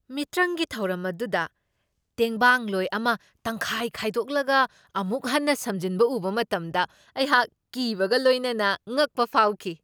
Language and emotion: Manipuri, surprised